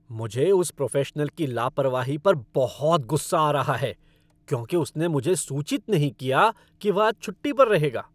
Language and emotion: Hindi, angry